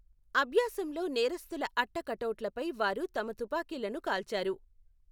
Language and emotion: Telugu, neutral